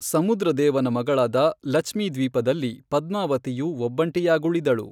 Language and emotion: Kannada, neutral